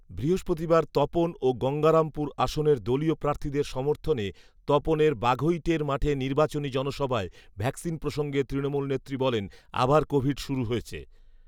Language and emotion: Bengali, neutral